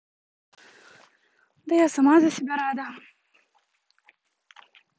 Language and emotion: Russian, neutral